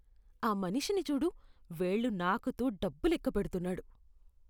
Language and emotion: Telugu, disgusted